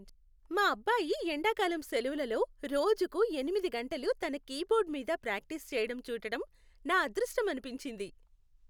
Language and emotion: Telugu, happy